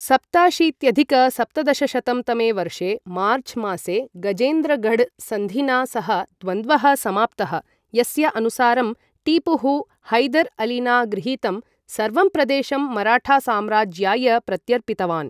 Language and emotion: Sanskrit, neutral